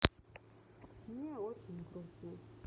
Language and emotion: Russian, sad